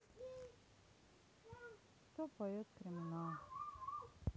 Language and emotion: Russian, sad